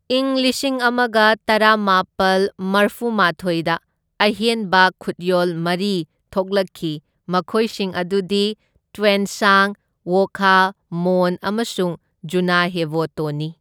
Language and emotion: Manipuri, neutral